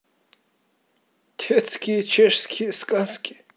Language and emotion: Russian, neutral